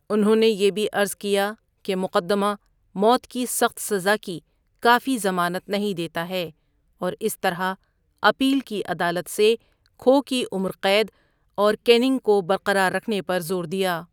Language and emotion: Urdu, neutral